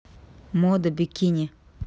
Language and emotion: Russian, neutral